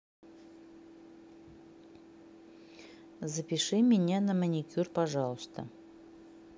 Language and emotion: Russian, neutral